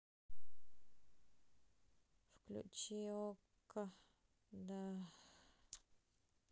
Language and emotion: Russian, sad